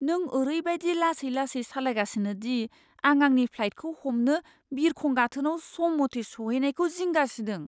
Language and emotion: Bodo, fearful